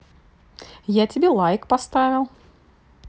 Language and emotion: Russian, positive